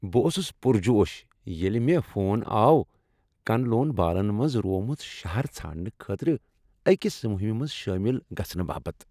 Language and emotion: Kashmiri, happy